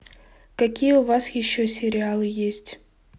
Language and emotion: Russian, neutral